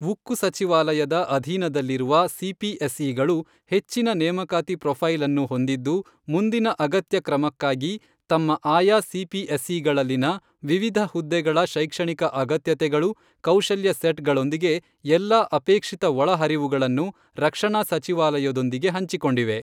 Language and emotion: Kannada, neutral